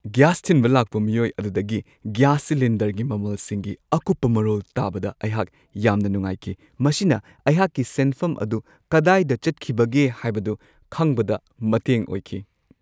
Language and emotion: Manipuri, happy